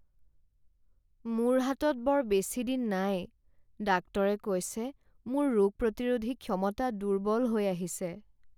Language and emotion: Assamese, sad